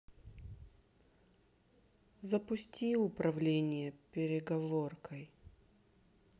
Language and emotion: Russian, sad